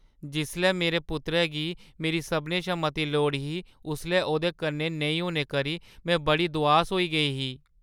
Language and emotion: Dogri, sad